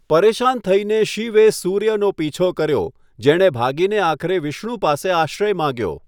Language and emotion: Gujarati, neutral